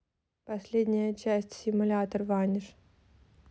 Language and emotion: Russian, neutral